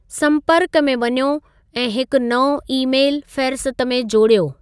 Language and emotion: Sindhi, neutral